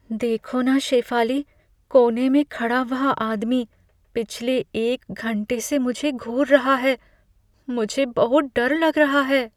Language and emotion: Hindi, fearful